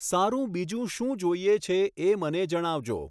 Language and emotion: Gujarati, neutral